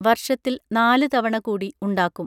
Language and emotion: Malayalam, neutral